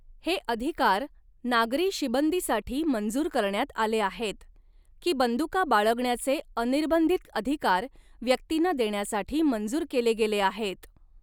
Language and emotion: Marathi, neutral